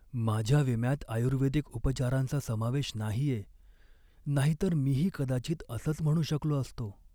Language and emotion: Marathi, sad